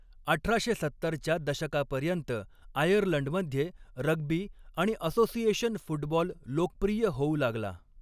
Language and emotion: Marathi, neutral